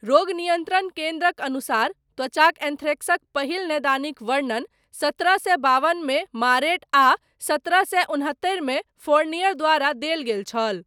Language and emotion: Maithili, neutral